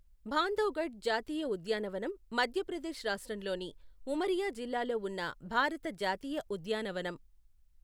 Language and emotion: Telugu, neutral